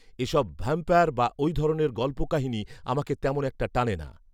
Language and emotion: Bengali, neutral